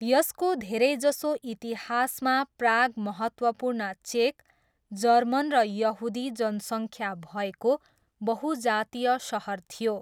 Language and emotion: Nepali, neutral